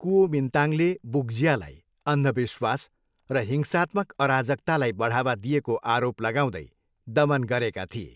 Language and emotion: Nepali, neutral